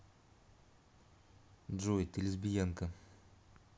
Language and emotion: Russian, neutral